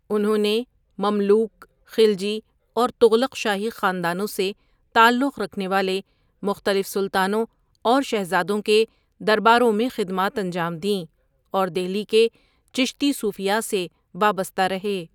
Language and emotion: Urdu, neutral